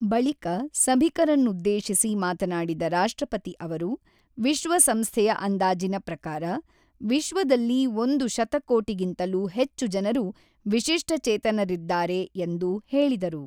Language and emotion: Kannada, neutral